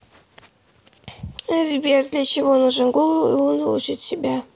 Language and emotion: Russian, sad